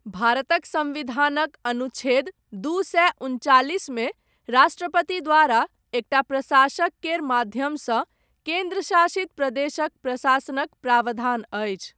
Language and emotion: Maithili, neutral